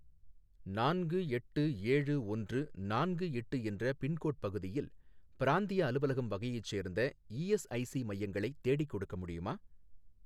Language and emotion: Tamil, neutral